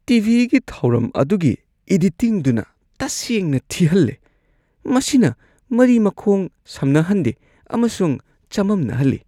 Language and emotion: Manipuri, disgusted